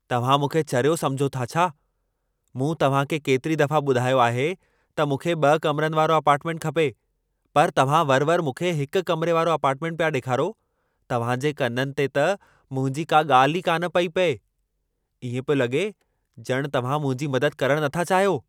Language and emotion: Sindhi, angry